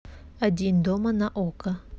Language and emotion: Russian, neutral